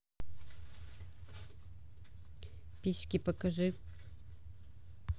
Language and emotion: Russian, neutral